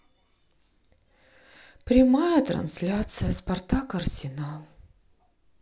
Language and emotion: Russian, sad